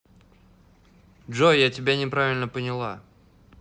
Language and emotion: Russian, neutral